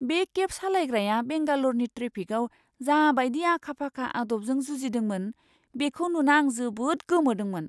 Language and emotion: Bodo, surprised